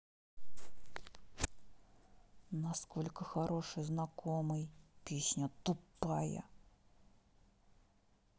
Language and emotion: Russian, angry